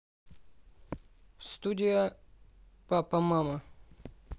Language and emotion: Russian, neutral